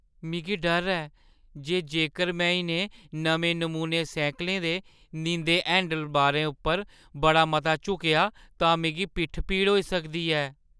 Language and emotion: Dogri, fearful